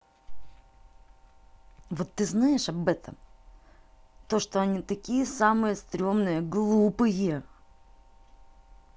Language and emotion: Russian, angry